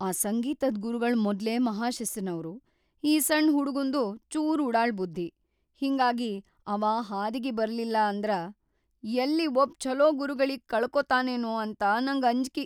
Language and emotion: Kannada, fearful